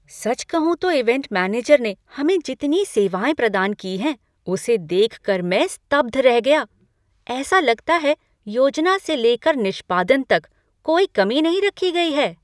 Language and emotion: Hindi, surprised